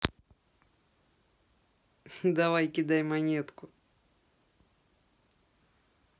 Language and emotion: Russian, positive